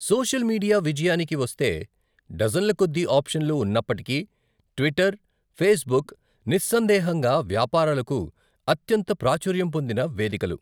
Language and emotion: Telugu, neutral